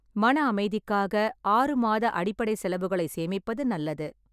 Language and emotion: Tamil, neutral